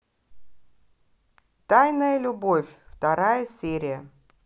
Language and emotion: Russian, neutral